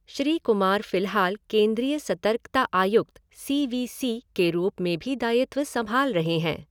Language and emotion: Hindi, neutral